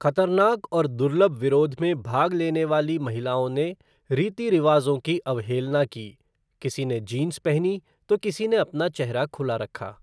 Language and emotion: Hindi, neutral